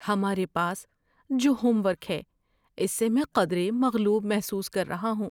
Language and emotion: Urdu, fearful